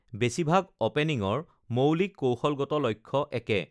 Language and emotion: Assamese, neutral